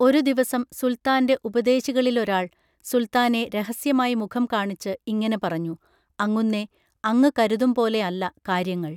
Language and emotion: Malayalam, neutral